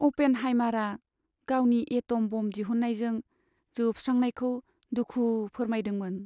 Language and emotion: Bodo, sad